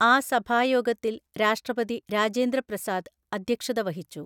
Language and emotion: Malayalam, neutral